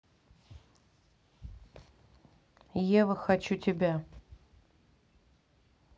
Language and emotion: Russian, neutral